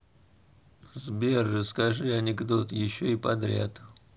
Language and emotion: Russian, neutral